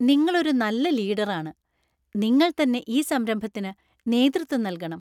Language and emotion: Malayalam, happy